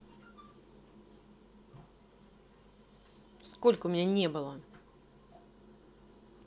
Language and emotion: Russian, angry